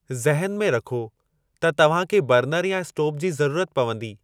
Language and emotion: Sindhi, neutral